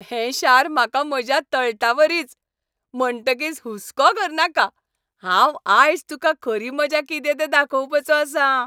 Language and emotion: Goan Konkani, happy